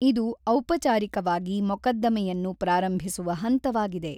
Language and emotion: Kannada, neutral